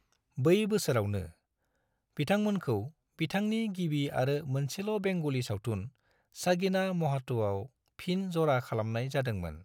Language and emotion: Bodo, neutral